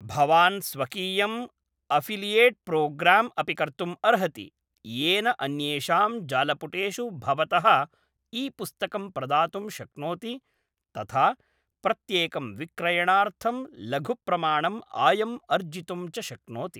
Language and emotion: Sanskrit, neutral